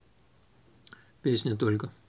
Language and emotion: Russian, neutral